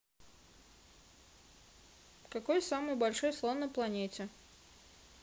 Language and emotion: Russian, neutral